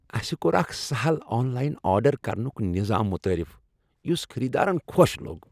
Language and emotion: Kashmiri, happy